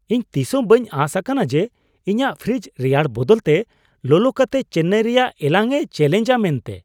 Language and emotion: Santali, surprised